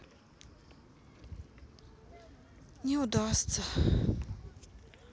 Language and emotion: Russian, sad